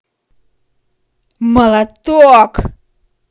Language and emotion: Russian, angry